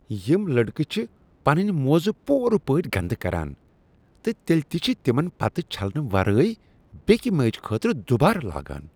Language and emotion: Kashmiri, disgusted